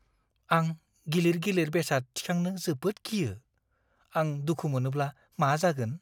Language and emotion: Bodo, fearful